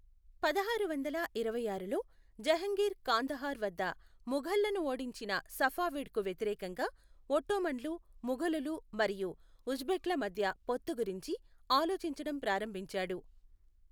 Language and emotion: Telugu, neutral